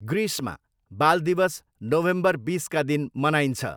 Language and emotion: Nepali, neutral